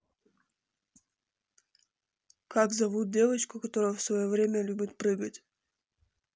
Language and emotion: Russian, neutral